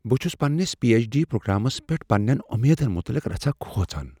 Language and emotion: Kashmiri, fearful